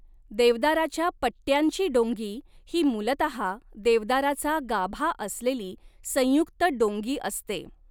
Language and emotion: Marathi, neutral